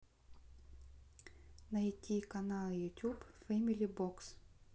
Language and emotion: Russian, neutral